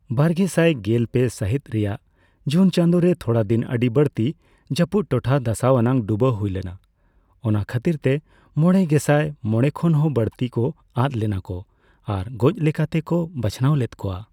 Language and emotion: Santali, neutral